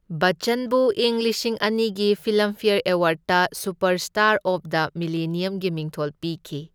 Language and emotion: Manipuri, neutral